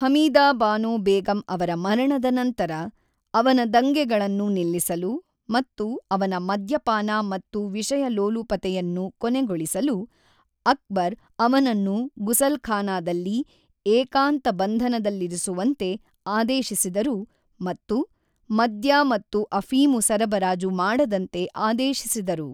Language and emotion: Kannada, neutral